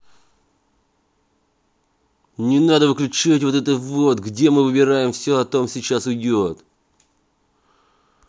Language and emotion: Russian, angry